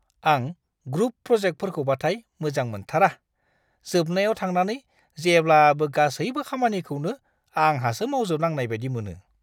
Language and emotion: Bodo, disgusted